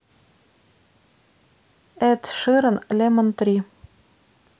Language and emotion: Russian, neutral